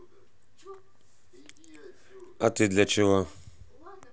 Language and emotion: Russian, angry